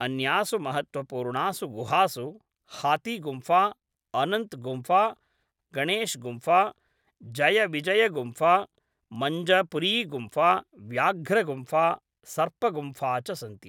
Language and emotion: Sanskrit, neutral